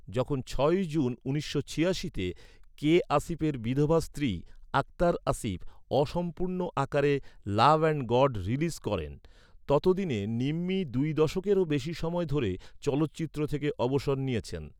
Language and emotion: Bengali, neutral